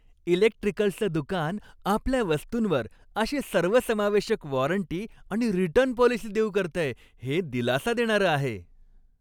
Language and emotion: Marathi, happy